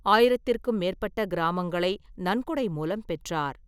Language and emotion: Tamil, neutral